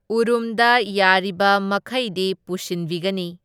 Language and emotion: Manipuri, neutral